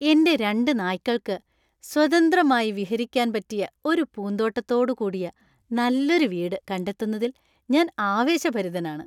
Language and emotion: Malayalam, happy